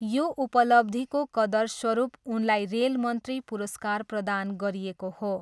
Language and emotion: Nepali, neutral